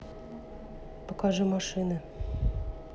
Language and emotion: Russian, neutral